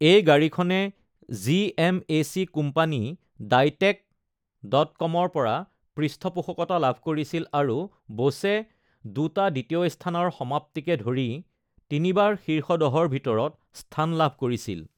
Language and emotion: Assamese, neutral